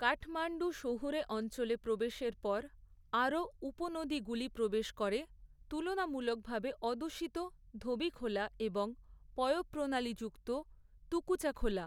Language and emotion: Bengali, neutral